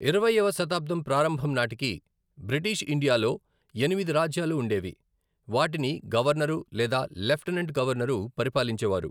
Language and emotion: Telugu, neutral